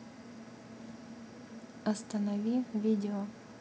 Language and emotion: Russian, neutral